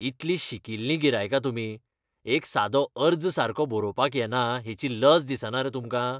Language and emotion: Goan Konkani, disgusted